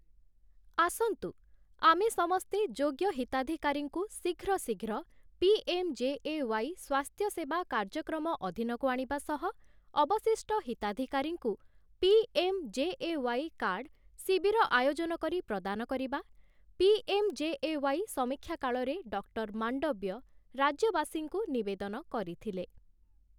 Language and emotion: Odia, neutral